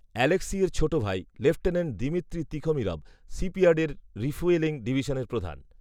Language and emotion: Bengali, neutral